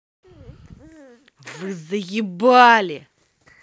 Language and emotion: Russian, angry